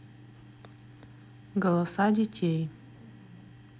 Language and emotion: Russian, neutral